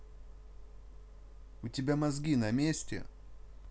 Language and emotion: Russian, angry